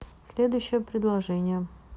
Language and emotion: Russian, neutral